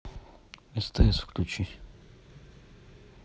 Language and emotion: Russian, neutral